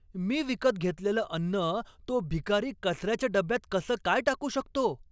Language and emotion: Marathi, angry